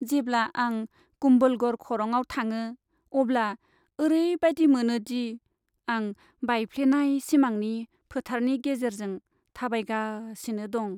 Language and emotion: Bodo, sad